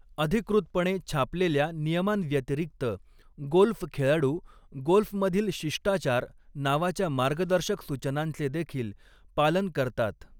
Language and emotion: Marathi, neutral